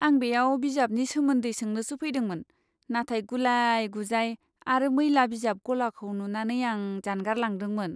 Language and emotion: Bodo, disgusted